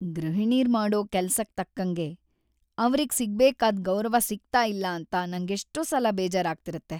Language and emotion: Kannada, sad